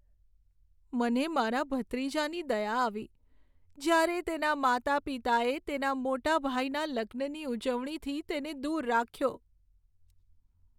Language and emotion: Gujarati, sad